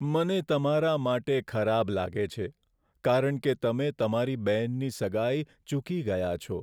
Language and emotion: Gujarati, sad